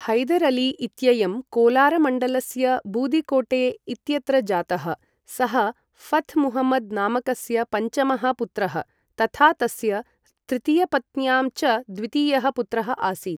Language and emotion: Sanskrit, neutral